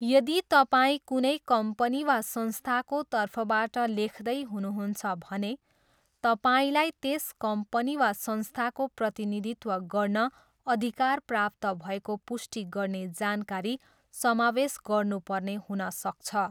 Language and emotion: Nepali, neutral